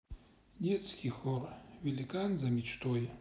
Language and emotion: Russian, sad